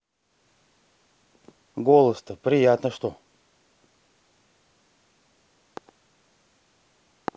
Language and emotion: Russian, neutral